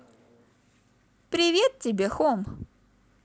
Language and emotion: Russian, positive